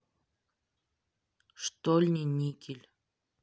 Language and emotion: Russian, neutral